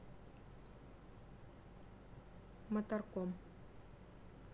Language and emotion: Russian, neutral